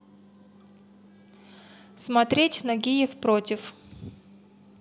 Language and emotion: Russian, neutral